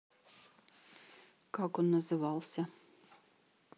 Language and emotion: Russian, neutral